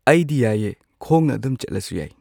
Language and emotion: Manipuri, neutral